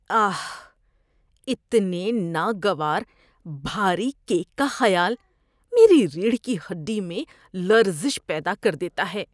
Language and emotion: Urdu, disgusted